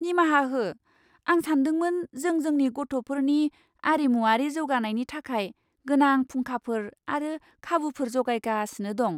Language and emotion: Bodo, surprised